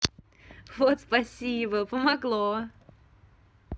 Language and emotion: Russian, positive